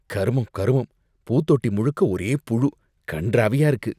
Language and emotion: Tamil, disgusted